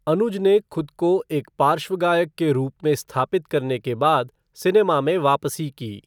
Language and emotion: Hindi, neutral